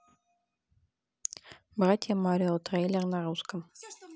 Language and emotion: Russian, neutral